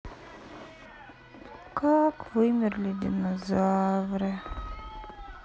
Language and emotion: Russian, sad